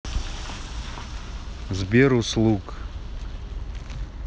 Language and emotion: Russian, neutral